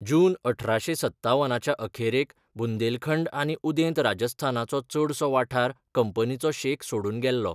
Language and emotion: Goan Konkani, neutral